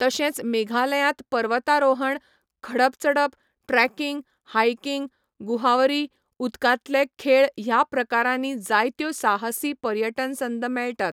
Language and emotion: Goan Konkani, neutral